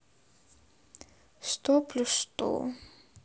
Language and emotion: Russian, sad